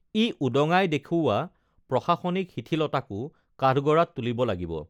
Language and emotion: Assamese, neutral